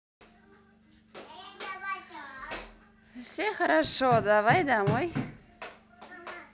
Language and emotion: Russian, positive